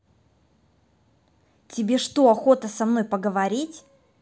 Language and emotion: Russian, angry